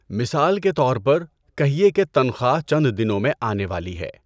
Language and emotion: Urdu, neutral